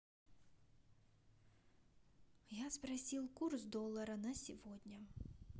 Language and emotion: Russian, neutral